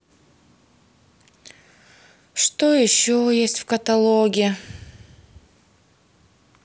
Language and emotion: Russian, sad